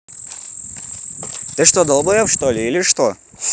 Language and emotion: Russian, angry